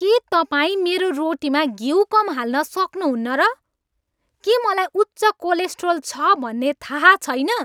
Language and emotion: Nepali, angry